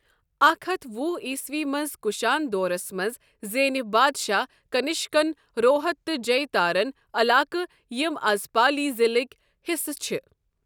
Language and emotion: Kashmiri, neutral